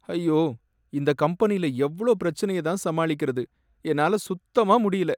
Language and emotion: Tamil, sad